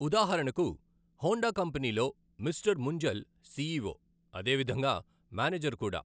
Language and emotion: Telugu, neutral